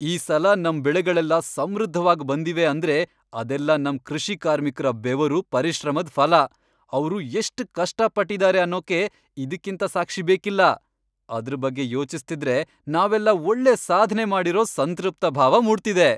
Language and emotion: Kannada, happy